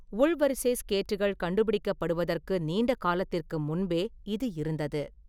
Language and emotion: Tamil, neutral